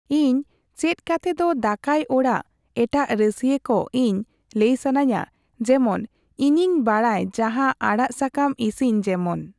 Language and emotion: Santali, neutral